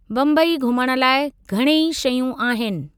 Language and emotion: Sindhi, neutral